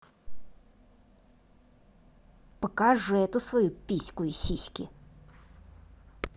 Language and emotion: Russian, angry